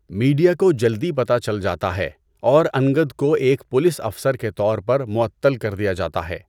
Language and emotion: Urdu, neutral